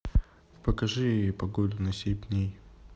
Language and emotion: Russian, neutral